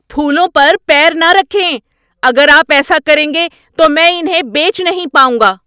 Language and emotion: Urdu, angry